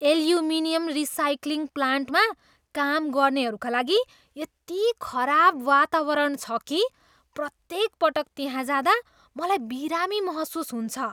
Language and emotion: Nepali, disgusted